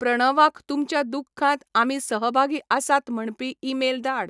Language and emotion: Goan Konkani, neutral